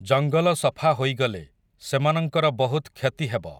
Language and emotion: Odia, neutral